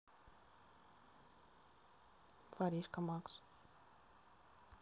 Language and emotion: Russian, neutral